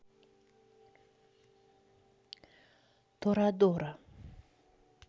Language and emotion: Russian, neutral